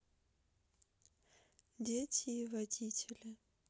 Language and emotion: Russian, sad